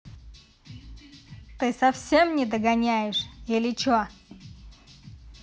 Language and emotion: Russian, angry